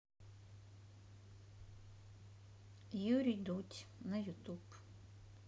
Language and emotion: Russian, neutral